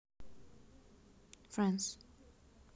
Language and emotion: Russian, neutral